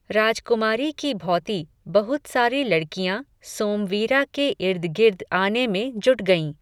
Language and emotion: Hindi, neutral